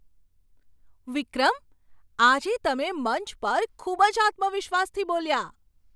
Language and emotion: Gujarati, surprised